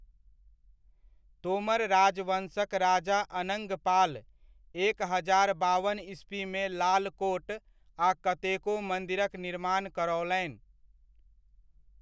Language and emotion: Maithili, neutral